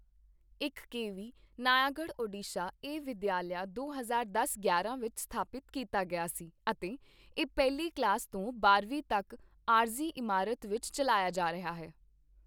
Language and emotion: Punjabi, neutral